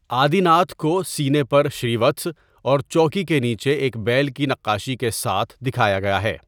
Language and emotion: Urdu, neutral